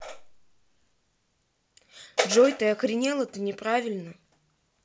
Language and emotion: Russian, angry